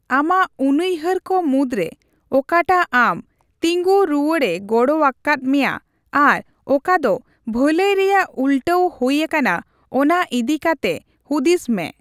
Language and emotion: Santali, neutral